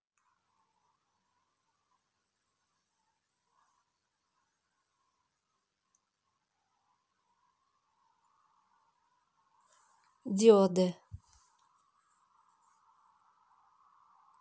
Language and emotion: Russian, neutral